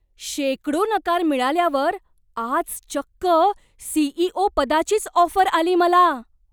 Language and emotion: Marathi, surprised